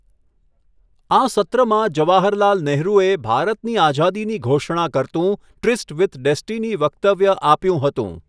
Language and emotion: Gujarati, neutral